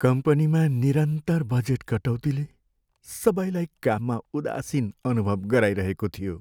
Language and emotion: Nepali, sad